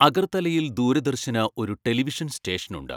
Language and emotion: Malayalam, neutral